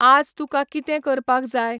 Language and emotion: Goan Konkani, neutral